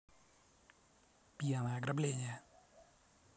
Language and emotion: Russian, positive